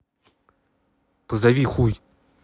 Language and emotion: Russian, angry